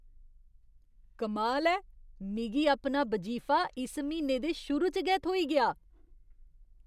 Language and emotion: Dogri, surprised